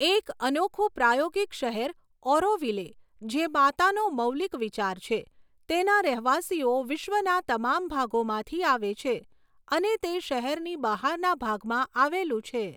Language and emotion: Gujarati, neutral